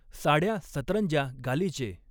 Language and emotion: Marathi, neutral